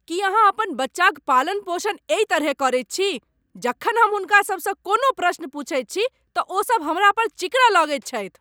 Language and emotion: Maithili, angry